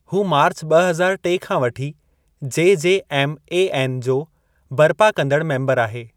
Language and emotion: Sindhi, neutral